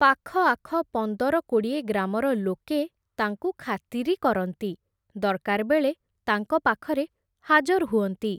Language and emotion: Odia, neutral